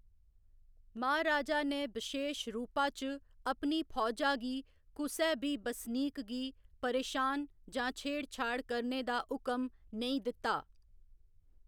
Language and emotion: Dogri, neutral